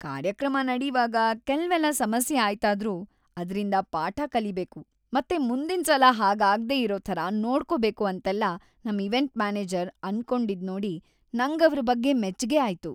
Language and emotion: Kannada, happy